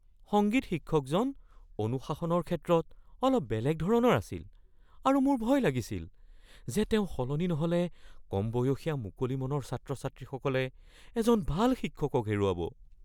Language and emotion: Assamese, fearful